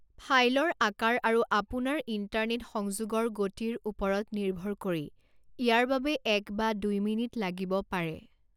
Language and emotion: Assamese, neutral